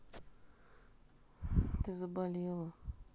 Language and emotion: Russian, sad